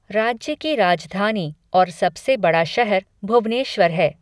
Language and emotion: Hindi, neutral